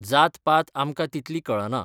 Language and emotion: Goan Konkani, neutral